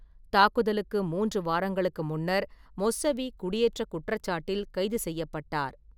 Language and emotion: Tamil, neutral